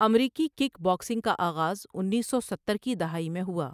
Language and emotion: Urdu, neutral